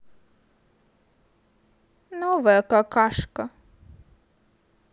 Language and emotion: Russian, neutral